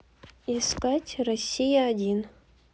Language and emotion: Russian, neutral